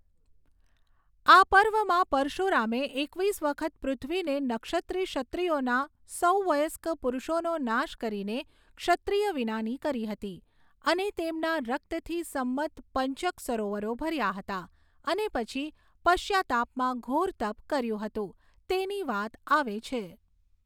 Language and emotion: Gujarati, neutral